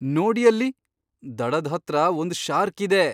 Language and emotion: Kannada, surprised